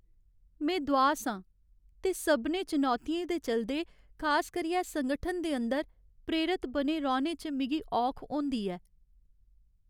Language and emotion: Dogri, sad